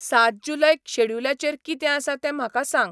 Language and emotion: Goan Konkani, neutral